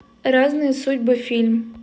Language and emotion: Russian, neutral